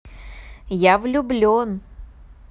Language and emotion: Russian, positive